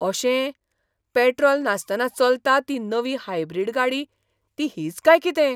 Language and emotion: Goan Konkani, surprised